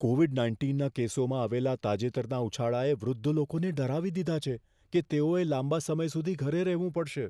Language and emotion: Gujarati, fearful